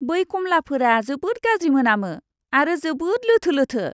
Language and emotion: Bodo, disgusted